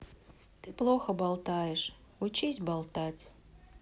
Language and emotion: Russian, sad